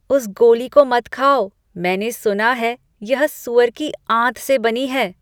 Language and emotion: Hindi, disgusted